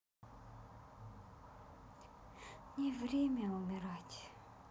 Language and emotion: Russian, sad